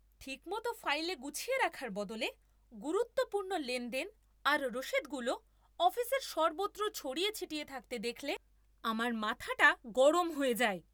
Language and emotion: Bengali, angry